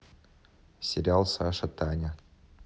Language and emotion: Russian, neutral